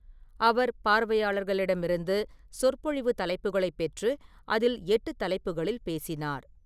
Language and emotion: Tamil, neutral